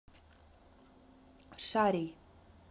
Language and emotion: Russian, neutral